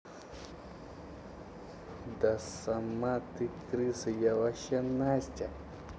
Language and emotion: Russian, angry